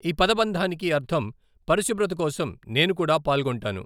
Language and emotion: Telugu, neutral